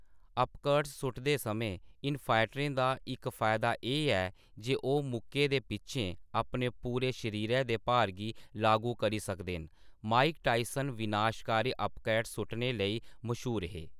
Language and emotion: Dogri, neutral